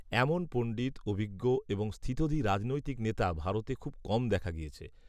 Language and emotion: Bengali, neutral